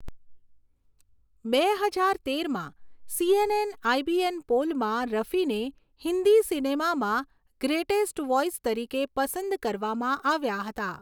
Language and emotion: Gujarati, neutral